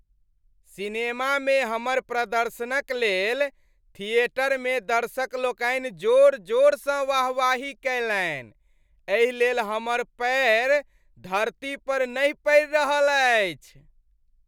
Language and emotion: Maithili, happy